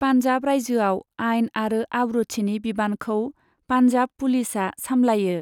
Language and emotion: Bodo, neutral